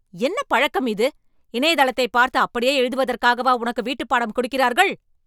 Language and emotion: Tamil, angry